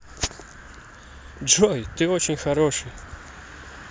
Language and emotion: Russian, positive